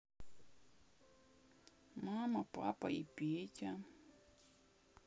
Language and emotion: Russian, sad